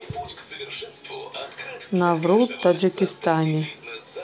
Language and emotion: Russian, neutral